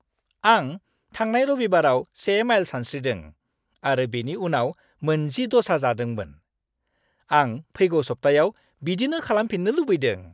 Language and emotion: Bodo, happy